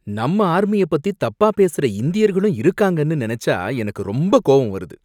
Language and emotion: Tamil, angry